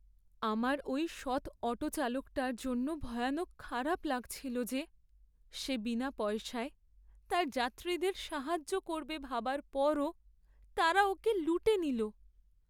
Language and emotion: Bengali, sad